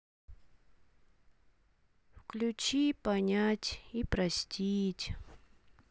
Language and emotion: Russian, sad